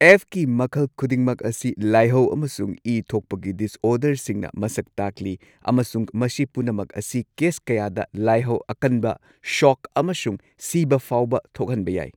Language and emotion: Manipuri, neutral